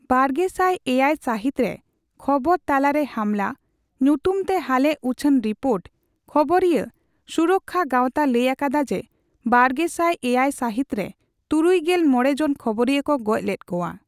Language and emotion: Santali, neutral